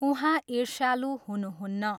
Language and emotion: Nepali, neutral